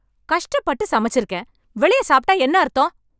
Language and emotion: Tamil, angry